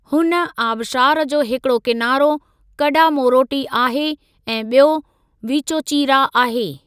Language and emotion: Sindhi, neutral